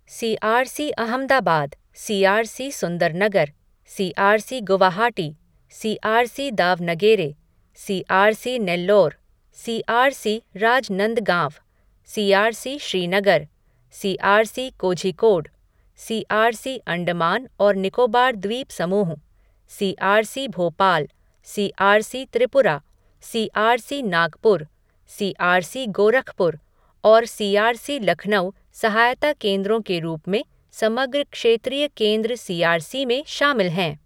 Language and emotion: Hindi, neutral